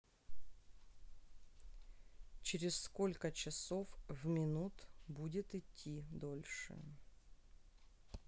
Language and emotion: Russian, neutral